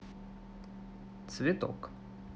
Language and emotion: Russian, neutral